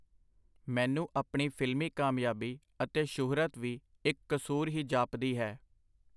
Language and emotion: Punjabi, neutral